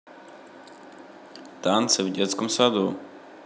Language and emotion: Russian, neutral